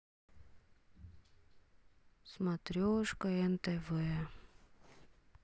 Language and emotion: Russian, sad